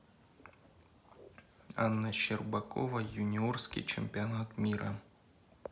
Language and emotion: Russian, neutral